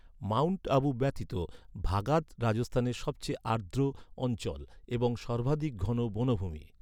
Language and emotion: Bengali, neutral